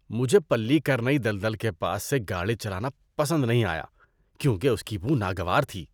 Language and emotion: Urdu, disgusted